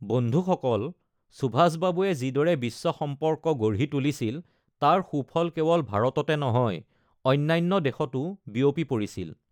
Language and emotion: Assamese, neutral